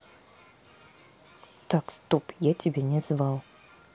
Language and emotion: Russian, neutral